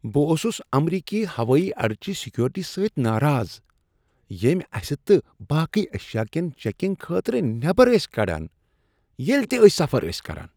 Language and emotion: Kashmiri, disgusted